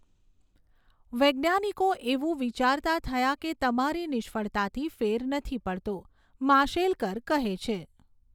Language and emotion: Gujarati, neutral